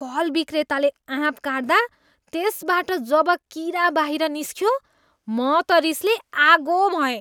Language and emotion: Nepali, disgusted